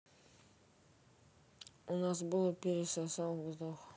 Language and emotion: Russian, sad